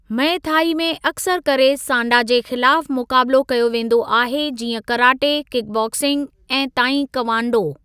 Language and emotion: Sindhi, neutral